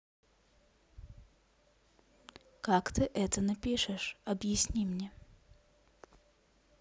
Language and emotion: Russian, neutral